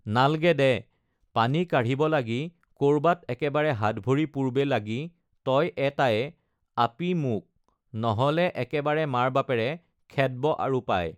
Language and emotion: Assamese, neutral